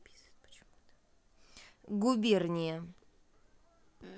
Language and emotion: Russian, neutral